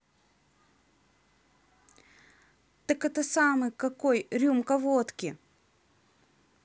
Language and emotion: Russian, neutral